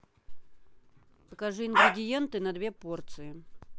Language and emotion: Russian, neutral